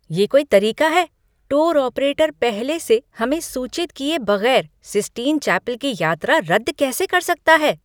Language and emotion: Hindi, angry